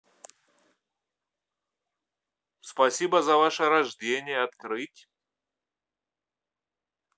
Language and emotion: Russian, neutral